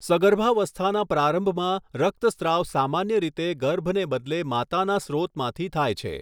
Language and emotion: Gujarati, neutral